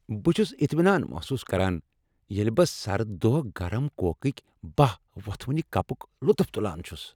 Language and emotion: Kashmiri, happy